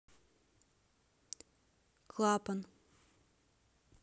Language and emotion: Russian, neutral